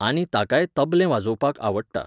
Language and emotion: Goan Konkani, neutral